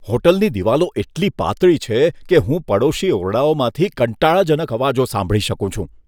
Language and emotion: Gujarati, disgusted